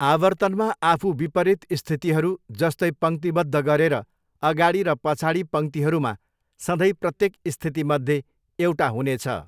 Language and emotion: Nepali, neutral